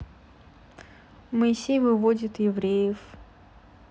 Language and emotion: Russian, neutral